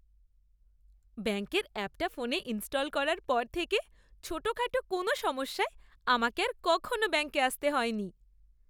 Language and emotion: Bengali, happy